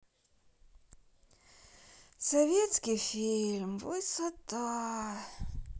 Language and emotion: Russian, sad